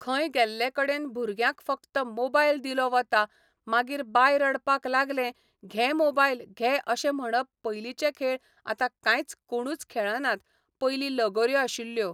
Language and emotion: Goan Konkani, neutral